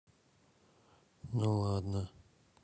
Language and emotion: Russian, neutral